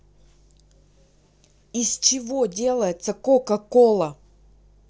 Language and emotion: Russian, angry